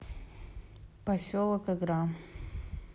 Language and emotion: Russian, neutral